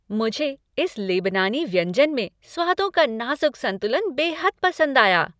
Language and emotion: Hindi, happy